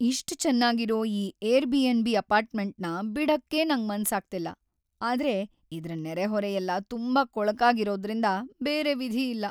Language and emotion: Kannada, sad